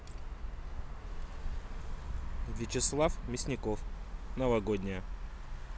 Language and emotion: Russian, neutral